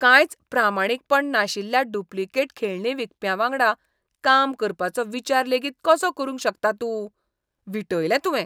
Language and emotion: Goan Konkani, disgusted